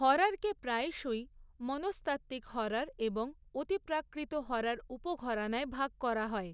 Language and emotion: Bengali, neutral